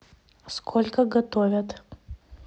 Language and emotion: Russian, neutral